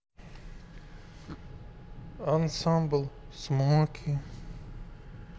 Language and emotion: Russian, sad